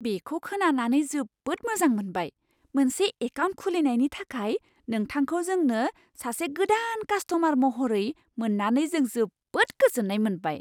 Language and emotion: Bodo, surprised